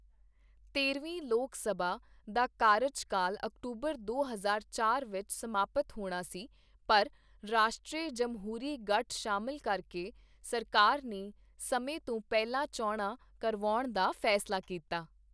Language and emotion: Punjabi, neutral